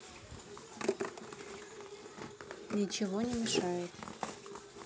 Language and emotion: Russian, neutral